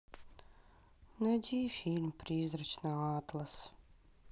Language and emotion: Russian, sad